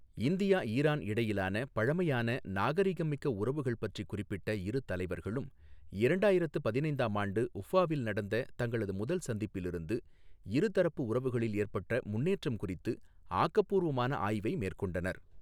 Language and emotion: Tamil, neutral